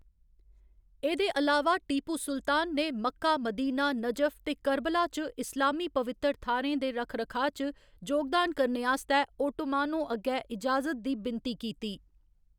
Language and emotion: Dogri, neutral